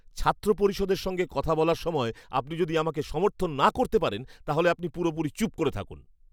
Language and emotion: Bengali, angry